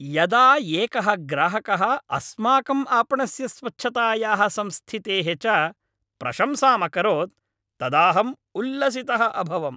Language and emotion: Sanskrit, happy